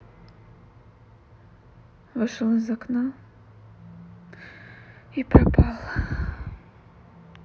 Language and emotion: Russian, sad